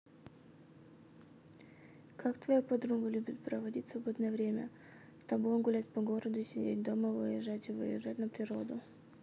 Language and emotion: Russian, neutral